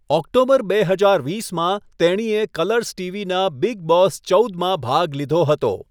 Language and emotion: Gujarati, neutral